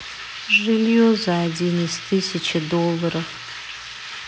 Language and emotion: Russian, sad